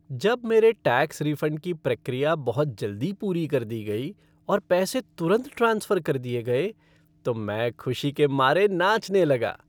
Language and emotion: Hindi, happy